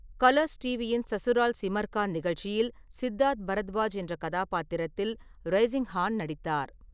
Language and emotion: Tamil, neutral